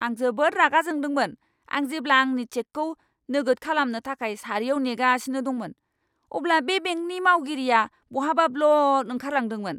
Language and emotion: Bodo, angry